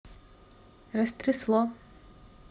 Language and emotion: Russian, neutral